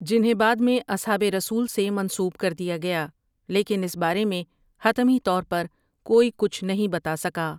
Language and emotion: Urdu, neutral